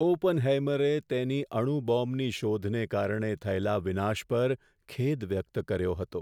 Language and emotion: Gujarati, sad